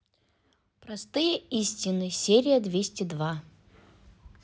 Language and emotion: Russian, neutral